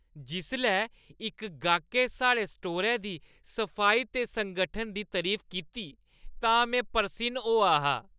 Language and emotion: Dogri, happy